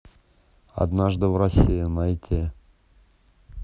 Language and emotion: Russian, neutral